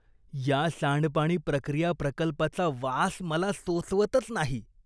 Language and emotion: Marathi, disgusted